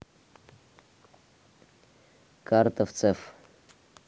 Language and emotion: Russian, neutral